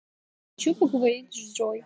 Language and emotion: Russian, neutral